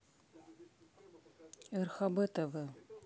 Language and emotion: Russian, neutral